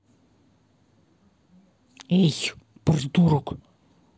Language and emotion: Russian, angry